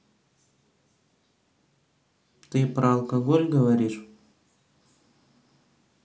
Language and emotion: Russian, neutral